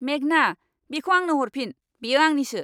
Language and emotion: Bodo, angry